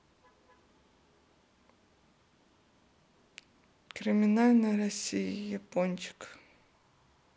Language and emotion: Russian, sad